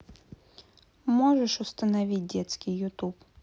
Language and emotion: Russian, neutral